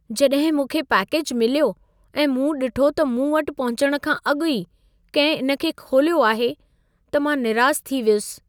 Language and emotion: Sindhi, sad